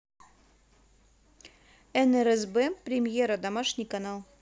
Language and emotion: Russian, neutral